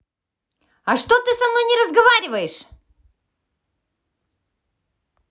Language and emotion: Russian, angry